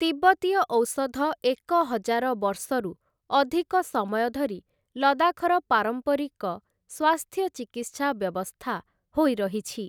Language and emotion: Odia, neutral